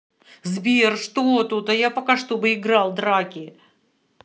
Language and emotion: Russian, sad